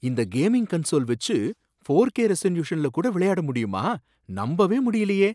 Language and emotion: Tamil, surprised